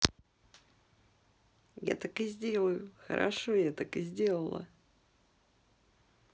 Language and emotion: Russian, positive